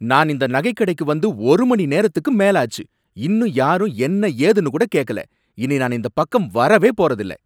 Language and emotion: Tamil, angry